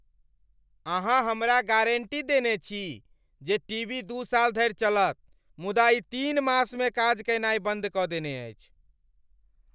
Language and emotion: Maithili, angry